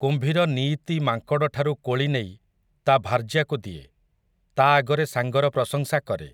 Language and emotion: Odia, neutral